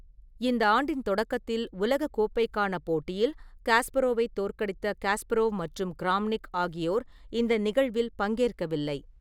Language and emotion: Tamil, neutral